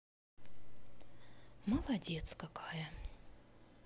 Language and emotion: Russian, sad